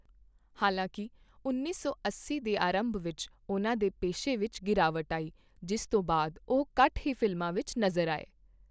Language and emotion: Punjabi, neutral